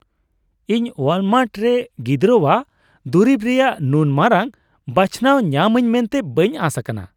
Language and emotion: Santali, surprised